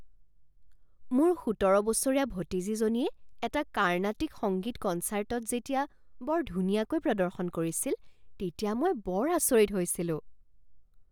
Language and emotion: Assamese, surprised